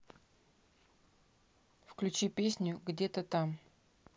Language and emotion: Russian, neutral